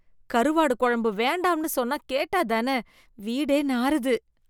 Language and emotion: Tamil, disgusted